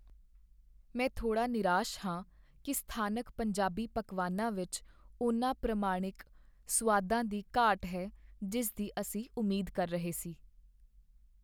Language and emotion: Punjabi, sad